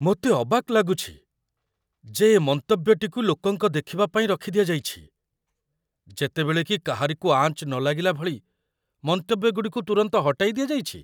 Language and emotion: Odia, surprised